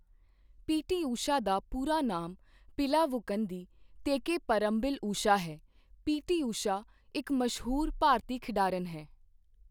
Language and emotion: Punjabi, neutral